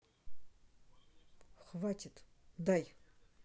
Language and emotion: Russian, angry